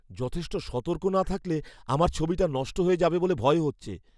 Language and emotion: Bengali, fearful